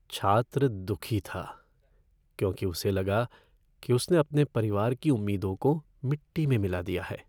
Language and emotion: Hindi, sad